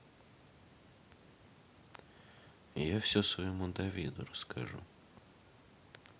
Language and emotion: Russian, neutral